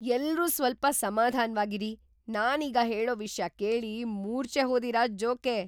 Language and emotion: Kannada, surprised